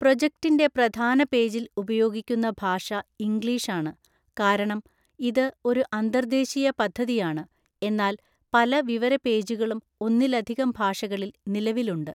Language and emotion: Malayalam, neutral